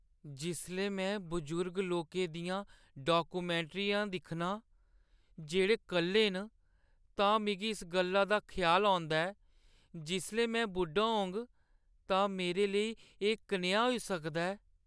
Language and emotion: Dogri, sad